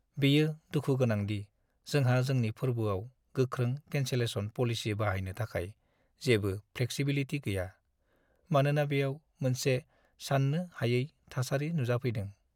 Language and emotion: Bodo, sad